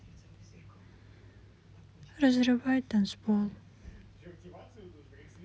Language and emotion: Russian, sad